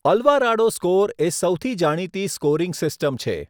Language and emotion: Gujarati, neutral